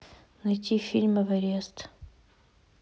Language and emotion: Russian, neutral